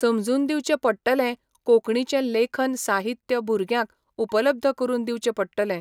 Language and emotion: Goan Konkani, neutral